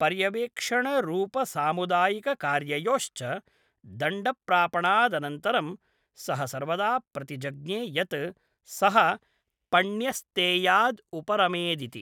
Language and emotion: Sanskrit, neutral